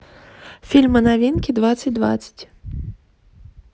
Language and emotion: Russian, neutral